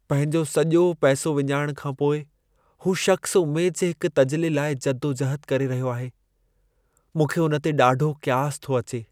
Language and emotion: Sindhi, sad